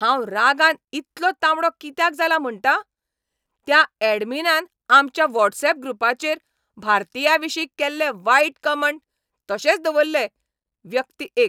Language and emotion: Goan Konkani, angry